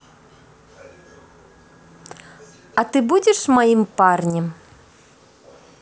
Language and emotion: Russian, positive